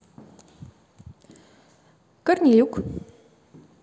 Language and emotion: Russian, positive